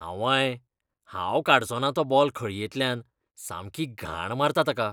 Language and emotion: Goan Konkani, disgusted